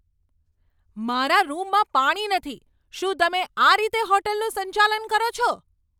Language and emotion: Gujarati, angry